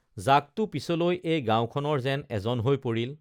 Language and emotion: Assamese, neutral